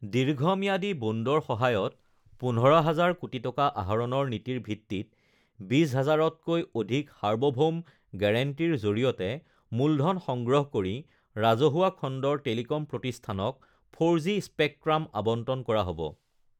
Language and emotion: Assamese, neutral